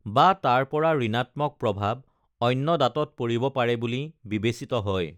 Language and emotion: Assamese, neutral